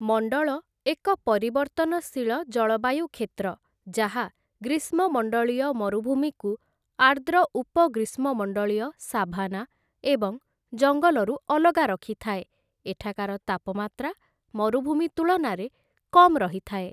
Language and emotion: Odia, neutral